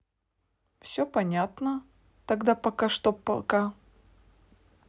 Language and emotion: Russian, neutral